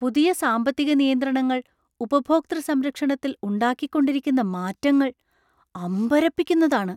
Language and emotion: Malayalam, surprised